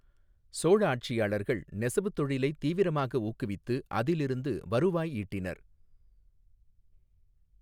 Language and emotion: Tamil, neutral